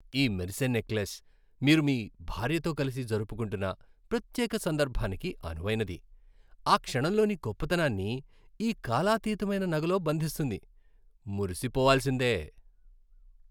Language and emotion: Telugu, happy